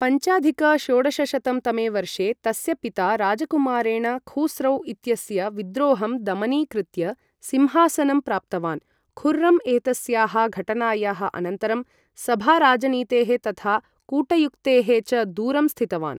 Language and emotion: Sanskrit, neutral